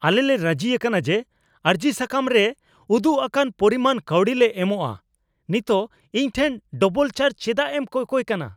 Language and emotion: Santali, angry